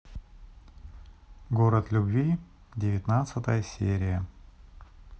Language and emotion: Russian, neutral